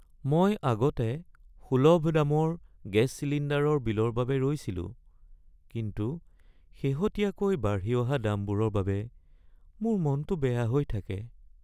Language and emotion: Assamese, sad